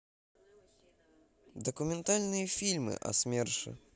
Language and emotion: Russian, neutral